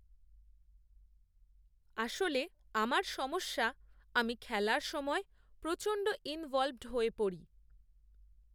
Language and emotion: Bengali, neutral